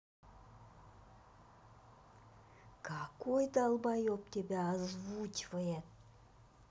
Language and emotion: Russian, angry